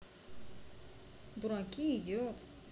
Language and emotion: Russian, neutral